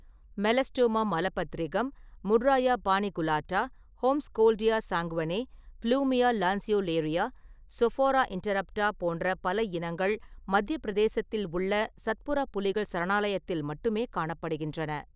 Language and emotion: Tamil, neutral